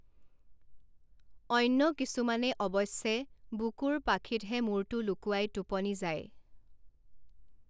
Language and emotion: Assamese, neutral